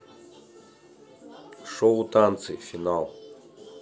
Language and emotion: Russian, neutral